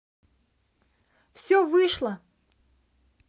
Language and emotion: Russian, positive